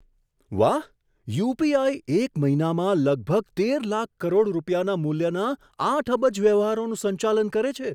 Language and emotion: Gujarati, surprised